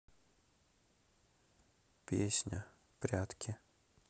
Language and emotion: Russian, sad